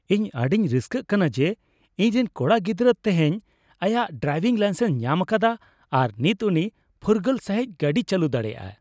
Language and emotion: Santali, happy